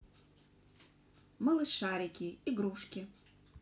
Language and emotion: Russian, neutral